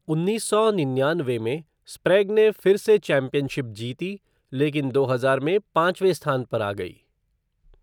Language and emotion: Hindi, neutral